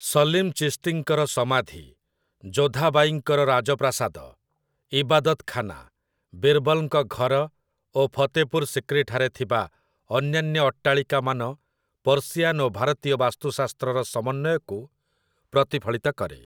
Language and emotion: Odia, neutral